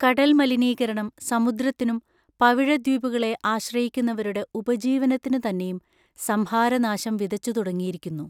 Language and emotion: Malayalam, neutral